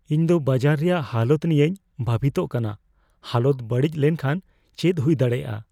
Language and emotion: Santali, fearful